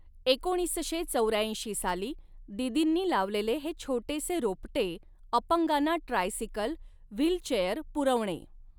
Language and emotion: Marathi, neutral